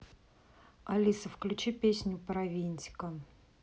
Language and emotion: Russian, neutral